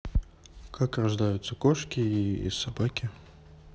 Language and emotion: Russian, neutral